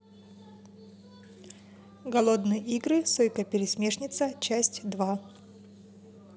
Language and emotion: Russian, neutral